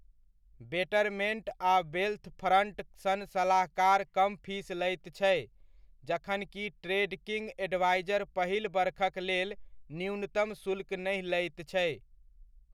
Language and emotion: Maithili, neutral